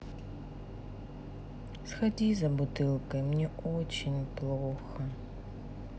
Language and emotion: Russian, sad